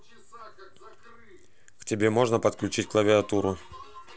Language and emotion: Russian, neutral